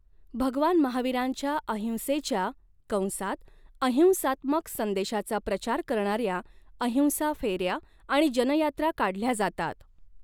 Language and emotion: Marathi, neutral